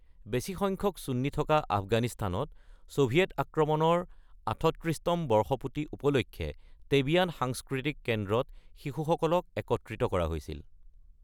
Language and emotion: Assamese, neutral